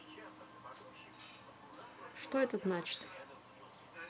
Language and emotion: Russian, neutral